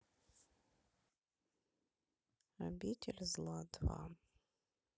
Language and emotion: Russian, sad